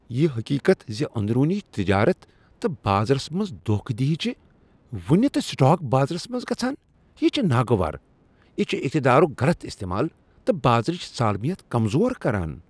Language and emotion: Kashmiri, disgusted